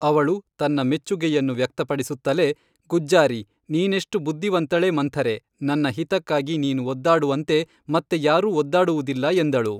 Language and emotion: Kannada, neutral